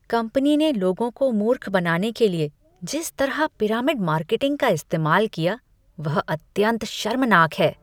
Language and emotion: Hindi, disgusted